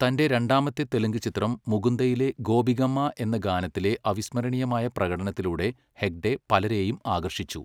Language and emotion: Malayalam, neutral